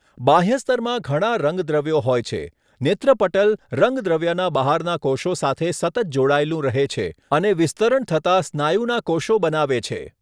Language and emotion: Gujarati, neutral